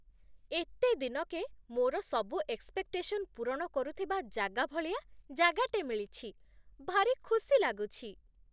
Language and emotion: Odia, happy